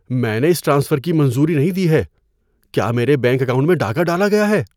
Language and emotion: Urdu, fearful